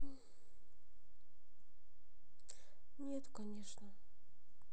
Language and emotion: Russian, sad